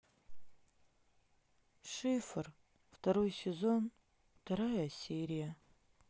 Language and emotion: Russian, sad